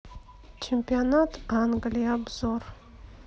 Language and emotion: Russian, neutral